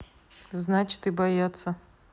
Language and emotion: Russian, neutral